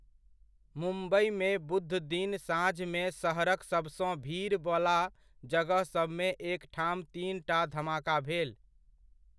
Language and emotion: Maithili, neutral